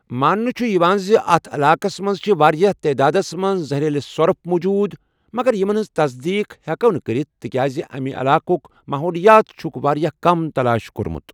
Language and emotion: Kashmiri, neutral